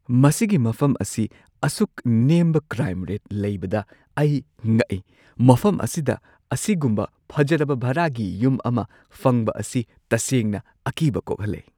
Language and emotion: Manipuri, surprised